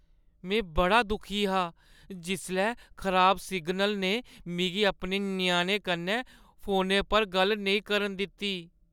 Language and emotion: Dogri, sad